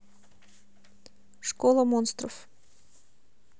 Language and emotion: Russian, neutral